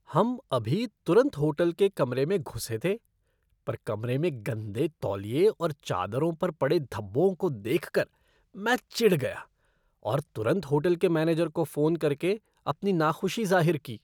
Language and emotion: Hindi, disgusted